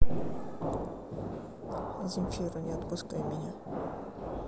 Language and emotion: Russian, neutral